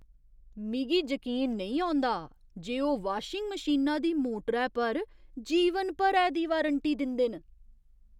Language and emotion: Dogri, surprised